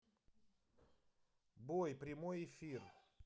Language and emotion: Russian, neutral